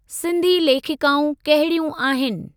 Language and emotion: Sindhi, neutral